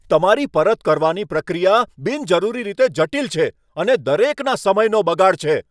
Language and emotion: Gujarati, angry